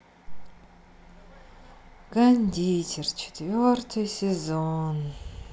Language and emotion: Russian, sad